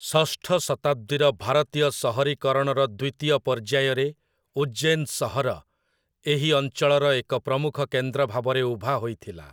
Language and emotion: Odia, neutral